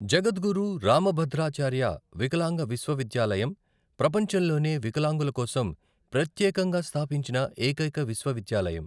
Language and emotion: Telugu, neutral